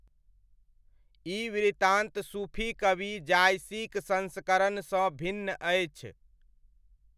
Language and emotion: Maithili, neutral